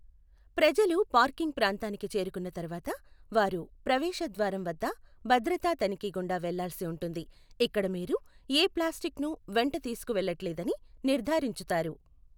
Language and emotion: Telugu, neutral